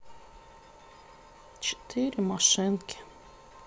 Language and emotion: Russian, sad